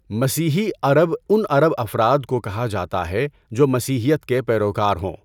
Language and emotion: Urdu, neutral